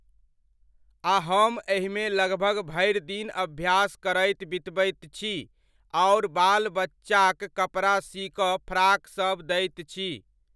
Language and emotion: Maithili, neutral